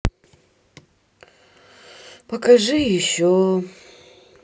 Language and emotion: Russian, sad